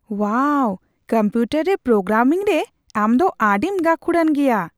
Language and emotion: Santali, surprised